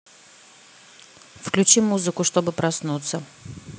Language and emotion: Russian, neutral